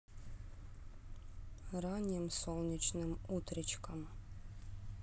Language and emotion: Russian, sad